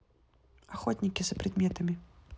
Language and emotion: Russian, neutral